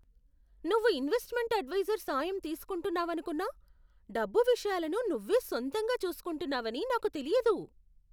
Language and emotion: Telugu, surprised